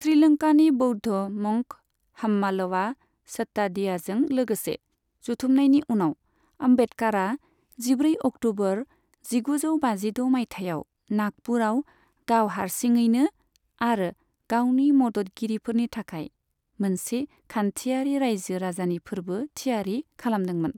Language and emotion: Bodo, neutral